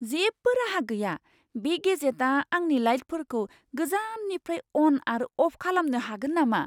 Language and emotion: Bodo, surprised